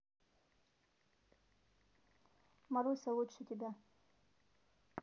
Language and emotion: Russian, neutral